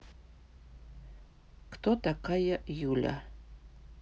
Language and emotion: Russian, neutral